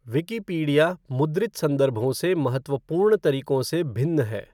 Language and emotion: Hindi, neutral